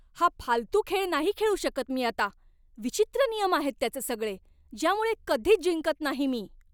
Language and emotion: Marathi, angry